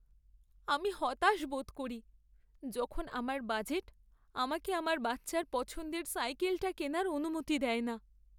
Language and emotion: Bengali, sad